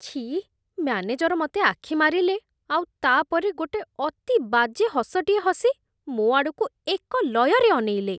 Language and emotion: Odia, disgusted